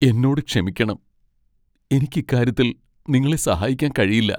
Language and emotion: Malayalam, sad